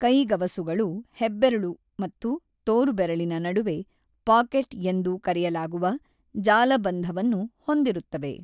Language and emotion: Kannada, neutral